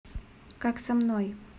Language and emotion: Russian, neutral